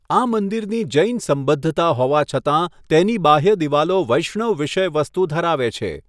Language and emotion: Gujarati, neutral